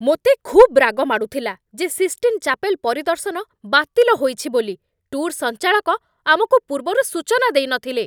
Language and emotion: Odia, angry